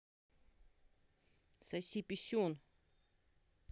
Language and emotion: Russian, angry